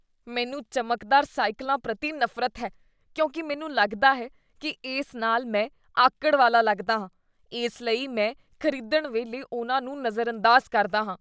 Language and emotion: Punjabi, disgusted